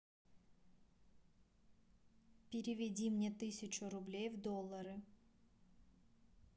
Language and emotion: Russian, neutral